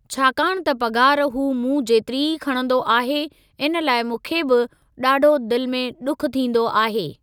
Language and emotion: Sindhi, neutral